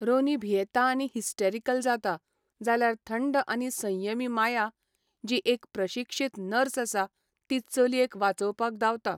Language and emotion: Goan Konkani, neutral